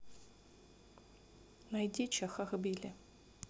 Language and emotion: Russian, neutral